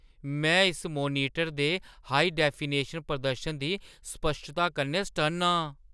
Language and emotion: Dogri, surprised